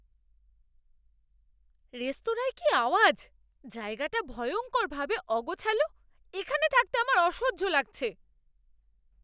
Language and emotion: Bengali, angry